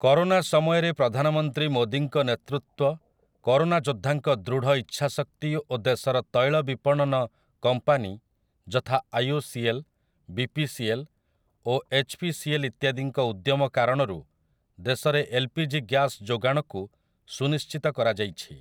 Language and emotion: Odia, neutral